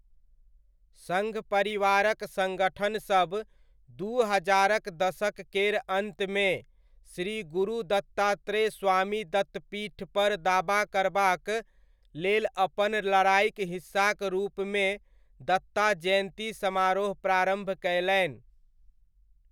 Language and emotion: Maithili, neutral